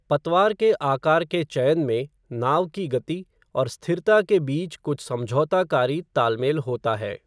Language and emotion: Hindi, neutral